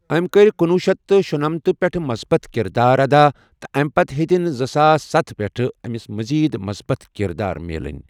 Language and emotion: Kashmiri, neutral